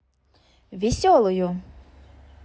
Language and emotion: Russian, positive